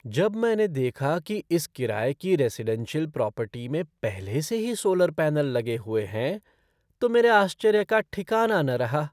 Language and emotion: Hindi, surprised